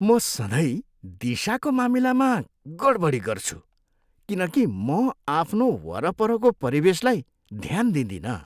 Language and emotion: Nepali, disgusted